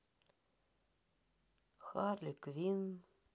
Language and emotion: Russian, sad